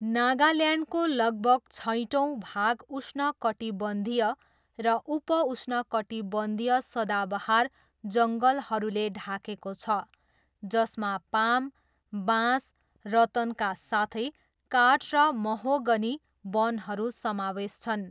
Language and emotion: Nepali, neutral